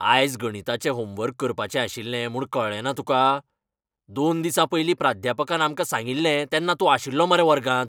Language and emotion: Goan Konkani, angry